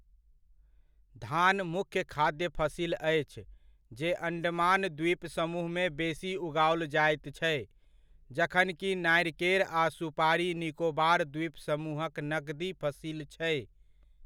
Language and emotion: Maithili, neutral